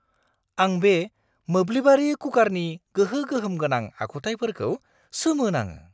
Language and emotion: Bodo, surprised